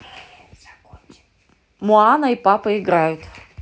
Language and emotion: Russian, neutral